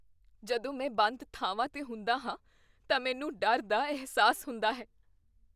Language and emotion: Punjabi, fearful